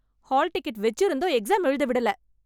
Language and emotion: Tamil, angry